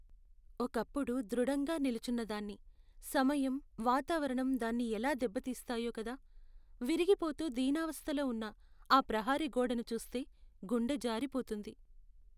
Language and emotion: Telugu, sad